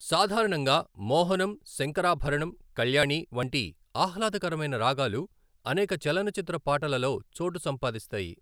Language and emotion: Telugu, neutral